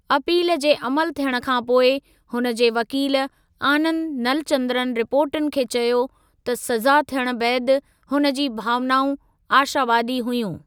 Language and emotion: Sindhi, neutral